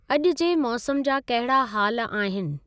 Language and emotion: Sindhi, neutral